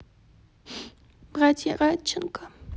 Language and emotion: Russian, sad